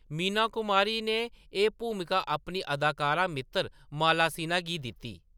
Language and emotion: Dogri, neutral